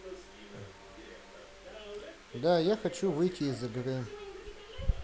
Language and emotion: Russian, neutral